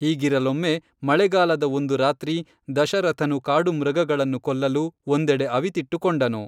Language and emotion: Kannada, neutral